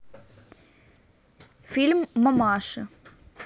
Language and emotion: Russian, neutral